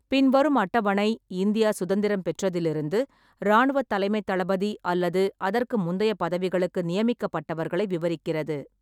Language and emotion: Tamil, neutral